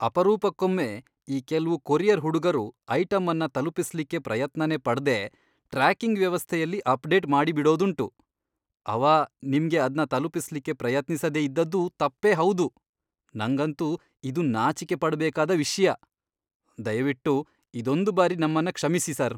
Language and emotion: Kannada, disgusted